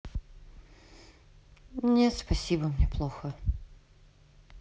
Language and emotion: Russian, sad